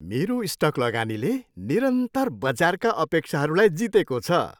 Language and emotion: Nepali, happy